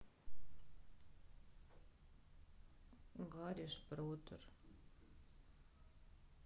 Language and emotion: Russian, sad